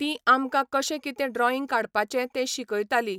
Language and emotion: Goan Konkani, neutral